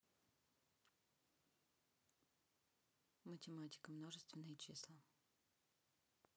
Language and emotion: Russian, neutral